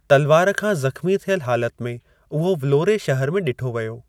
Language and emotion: Sindhi, neutral